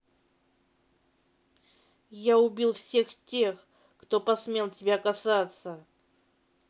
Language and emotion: Russian, angry